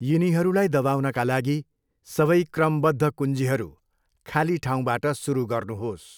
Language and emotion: Nepali, neutral